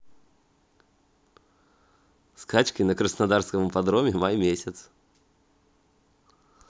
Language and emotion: Russian, positive